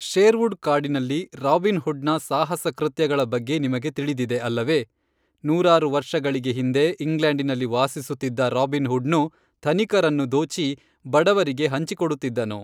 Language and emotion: Kannada, neutral